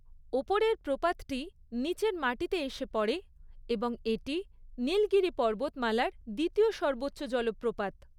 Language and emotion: Bengali, neutral